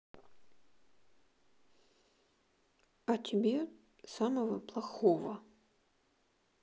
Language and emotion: Russian, sad